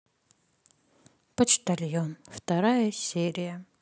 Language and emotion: Russian, sad